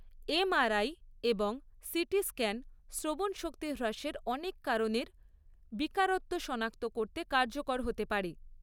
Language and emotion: Bengali, neutral